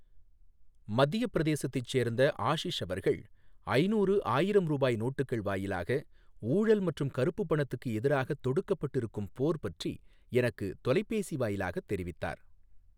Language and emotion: Tamil, neutral